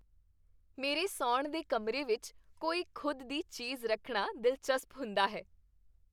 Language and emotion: Punjabi, happy